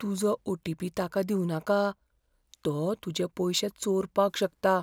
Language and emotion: Goan Konkani, fearful